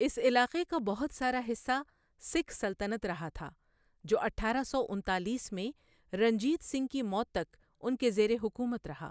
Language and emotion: Urdu, neutral